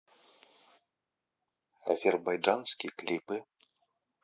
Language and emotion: Russian, neutral